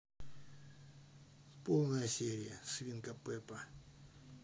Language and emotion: Russian, neutral